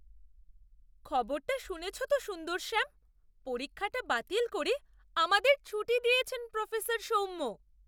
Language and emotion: Bengali, surprised